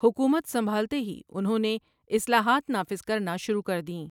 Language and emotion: Urdu, neutral